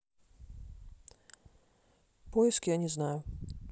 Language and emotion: Russian, neutral